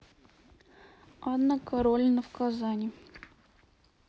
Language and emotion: Russian, neutral